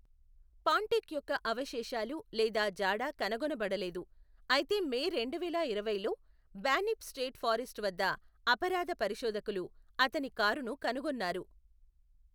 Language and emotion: Telugu, neutral